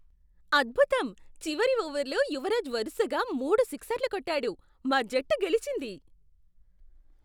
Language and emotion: Telugu, surprised